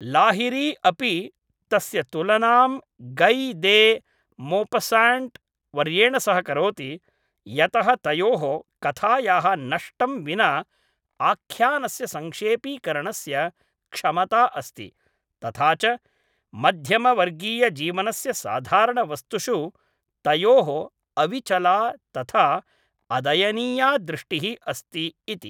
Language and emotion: Sanskrit, neutral